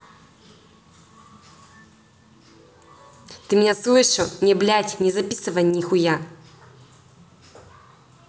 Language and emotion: Russian, angry